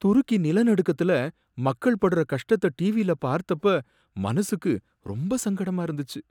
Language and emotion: Tamil, sad